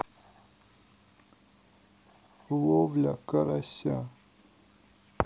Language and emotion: Russian, sad